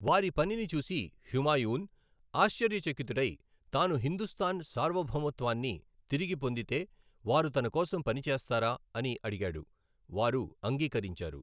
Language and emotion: Telugu, neutral